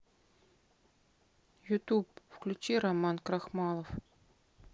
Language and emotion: Russian, sad